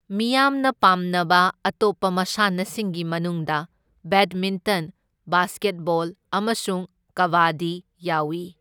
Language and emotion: Manipuri, neutral